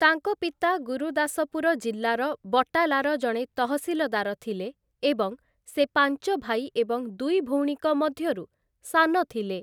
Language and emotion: Odia, neutral